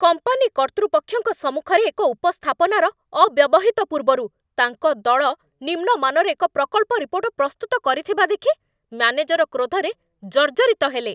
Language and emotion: Odia, angry